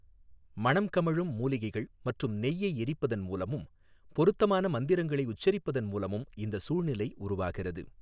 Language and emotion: Tamil, neutral